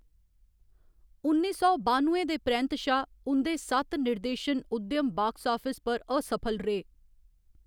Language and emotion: Dogri, neutral